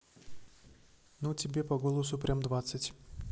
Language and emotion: Russian, neutral